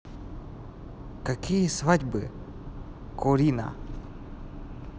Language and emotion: Russian, neutral